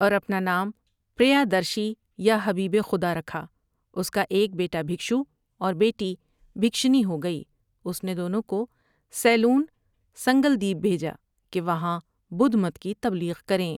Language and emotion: Urdu, neutral